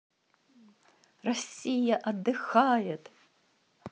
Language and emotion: Russian, positive